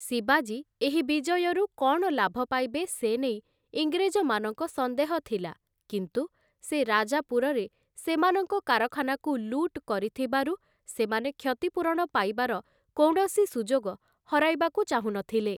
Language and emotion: Odia, neutral